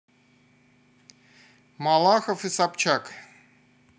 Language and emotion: Russian, neutral